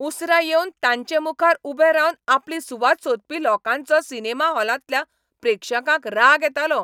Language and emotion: Goan Konkani, angry